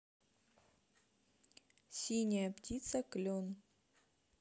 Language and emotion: Russian, neutral